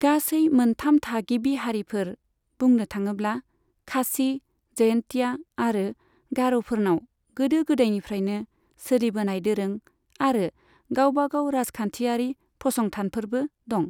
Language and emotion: Bodo, neutral